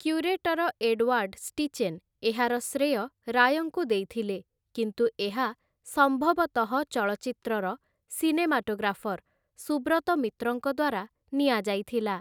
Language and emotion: Odia, neutral